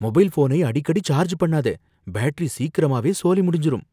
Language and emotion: Tamil, fearful